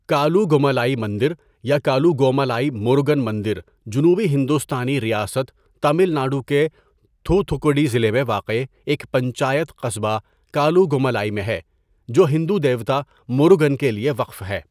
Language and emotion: Urdu, neutral